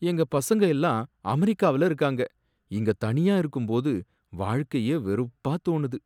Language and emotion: Tamil, sad